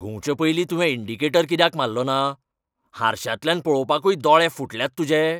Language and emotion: Goan Konkani, angry